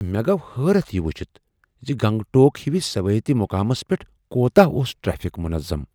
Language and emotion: Kashmiri, surprised